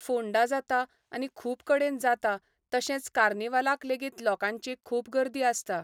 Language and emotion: Goan Konkani, neutral